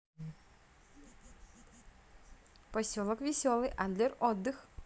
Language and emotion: Russian, positive